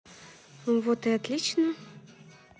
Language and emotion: Russian, positive